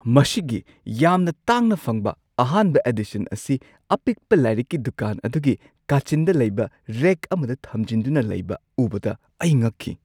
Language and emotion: Manipuri, surprised